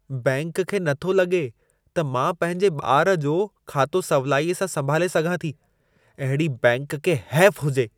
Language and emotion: Sindhi, disgusted